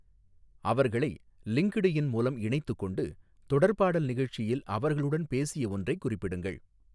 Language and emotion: Tamil, neutral